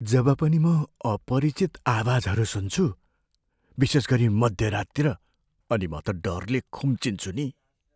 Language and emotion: Nepali, fearful